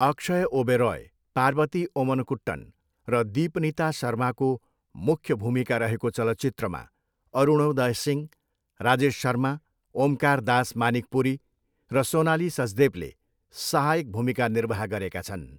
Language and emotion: Nepali, neutral